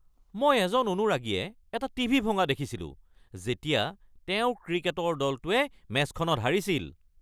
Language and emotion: Assamese, angry